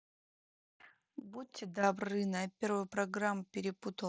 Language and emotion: Russian, neutral